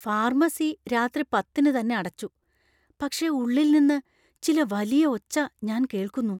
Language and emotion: Malayalam, fearful